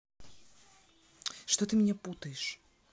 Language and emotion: Russian, angry